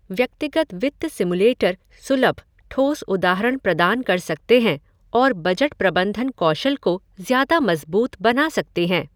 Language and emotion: Hindi, neutral